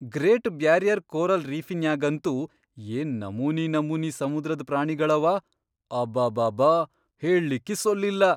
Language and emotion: Kannada, surprised